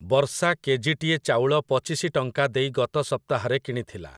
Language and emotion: Odia, neutral